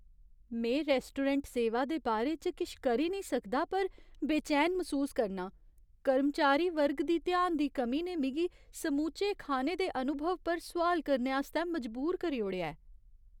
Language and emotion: Dogri, fearful